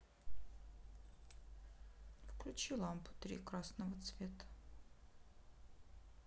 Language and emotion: Russian, sad